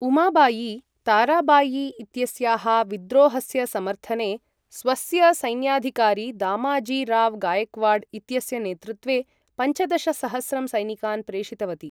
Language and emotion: Sanskrit, neutral